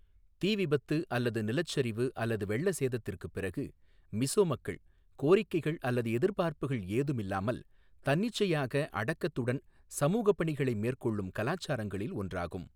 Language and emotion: Tamil, neutral